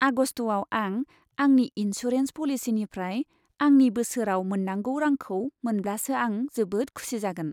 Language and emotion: Bodo, happy